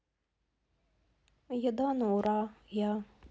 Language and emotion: Russian, neutral